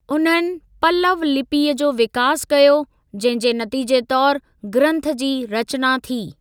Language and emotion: Sindhi, neutral